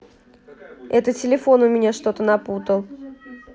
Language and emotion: Russian, neutral